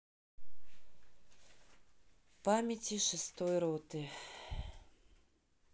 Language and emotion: Russian, sad